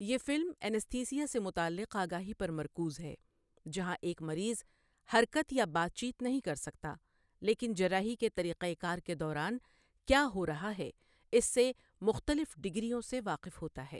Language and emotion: Urdu, neutral